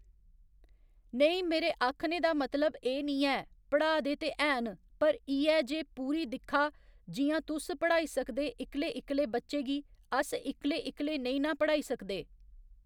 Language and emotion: Dogri, neutral